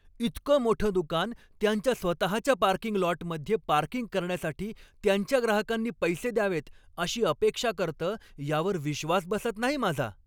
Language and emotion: Marathi, angry